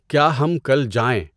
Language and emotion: Urdu, neutral